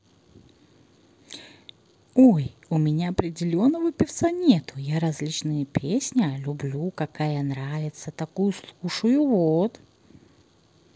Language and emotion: Russian, positive